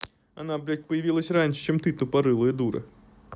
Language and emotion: Russian, angry